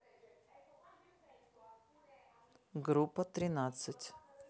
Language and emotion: Russian, neutral